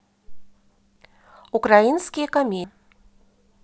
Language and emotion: Russian, neutral